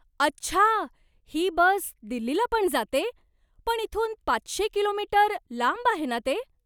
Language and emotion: Marathi, surprised